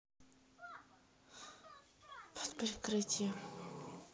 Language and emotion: Russian, neutral